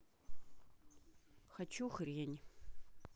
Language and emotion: Russian, neutral